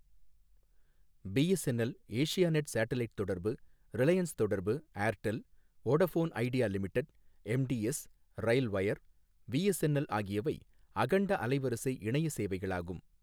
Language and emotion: Tamil, neutral